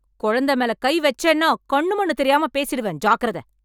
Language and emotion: Tamil, angry